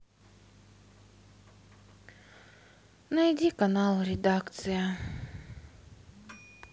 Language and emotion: Russian, sad